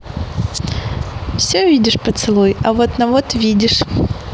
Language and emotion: Russian, positive